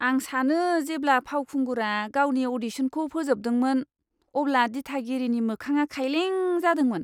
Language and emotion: Bodo, disgusted